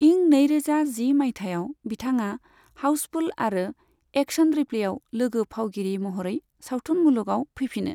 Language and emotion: Bodo, neutral